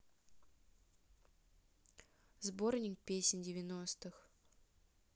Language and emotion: Russian, neutral